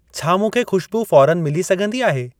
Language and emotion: Sindhi, neutral